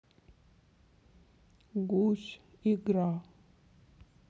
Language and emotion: Russian, sad